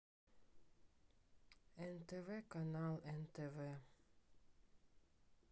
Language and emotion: Russian, sad